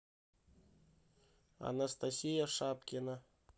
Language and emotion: Russian, neutral